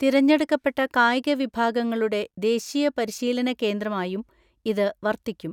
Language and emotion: Malayalam, neutral